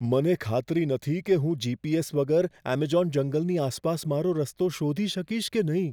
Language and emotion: Gujarati, fearful